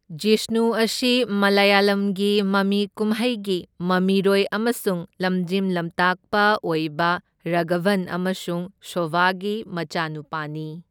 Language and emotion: Manipuri, neutral